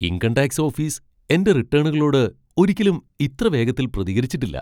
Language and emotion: Malayalam, surprised